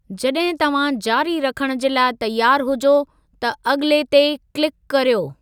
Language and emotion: Sindhi, neutral